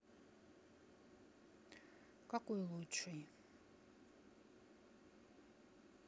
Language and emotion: Russian, neutral